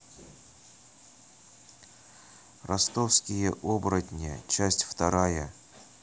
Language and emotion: Russian, neutral